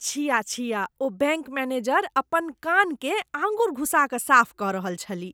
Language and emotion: Maithili, disgusted